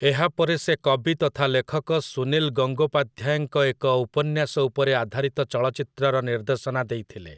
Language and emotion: Odia, neutral